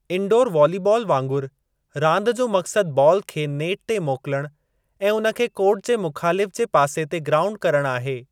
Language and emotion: Sindhi, neutral